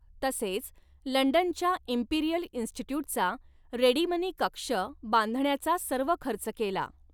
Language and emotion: Marathi, neutral